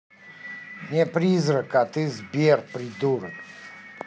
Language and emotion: Russian, angry